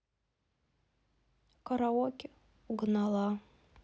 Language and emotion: Russian, sad